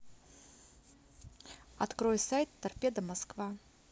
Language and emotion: Russian, neutral